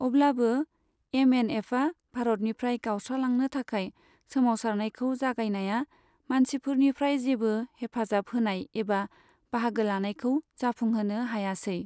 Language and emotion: Bodo, neutral